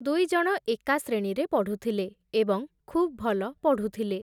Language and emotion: Odia, neutral